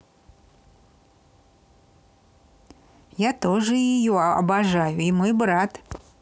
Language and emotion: Russian, positive